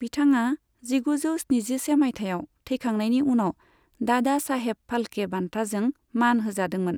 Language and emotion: Bodo, neutral